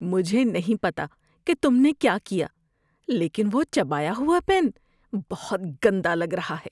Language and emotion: Urdu, disgusted